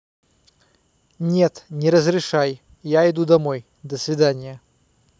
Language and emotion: Russian, angry